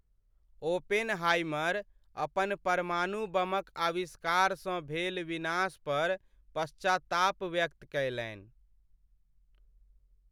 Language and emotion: Maithili, sad